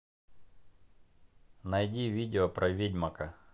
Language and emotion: Russian, neutral